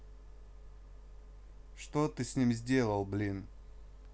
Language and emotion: Russian, neutral